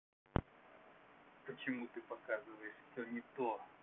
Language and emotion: Russian, angry